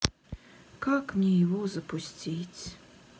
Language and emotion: Russian, sad